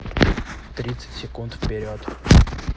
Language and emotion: Russian, neutral